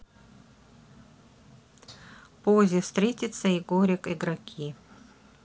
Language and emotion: Russian, neutral